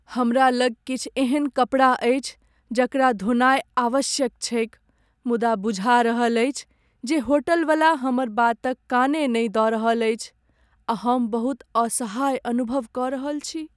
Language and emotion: Maithili, sad